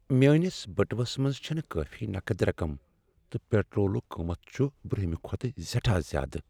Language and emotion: Kashmiri, sad